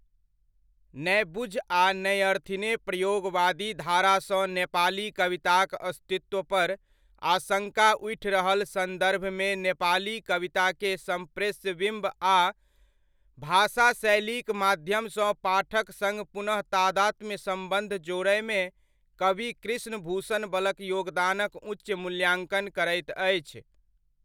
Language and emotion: Maithili, neutral